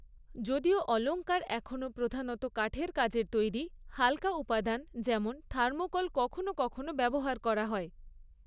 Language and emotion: Bengali, neutral